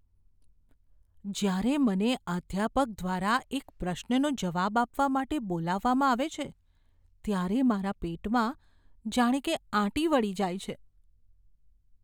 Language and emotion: Gujarati, fearful